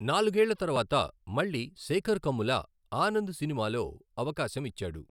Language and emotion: Telugu, neutral